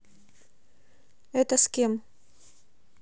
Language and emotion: Russian, neutral